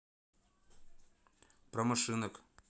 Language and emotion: Russian, neutral